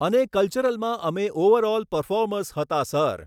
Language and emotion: Gujarati, neutral